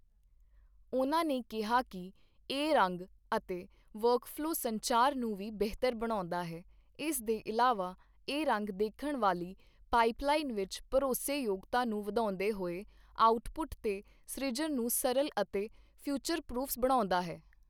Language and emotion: Punjabi, neutral